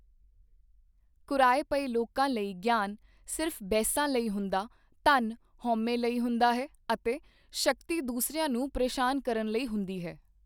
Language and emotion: Punjabi, neutral